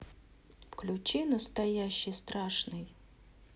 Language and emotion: Russian, neutral